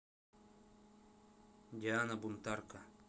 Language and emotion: Russian, neutral